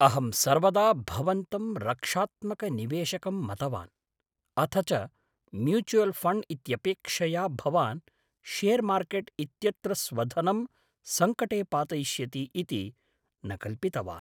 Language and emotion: Sanskrit, surprised